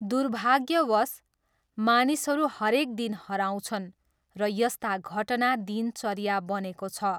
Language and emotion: Nepali, neutral